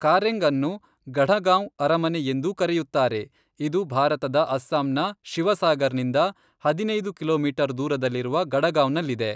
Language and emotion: Kannada, neutral